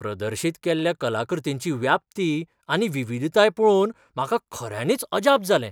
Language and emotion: Goan Konkani, surprised